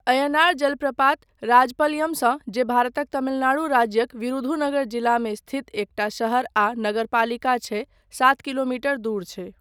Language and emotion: Maithili, neutral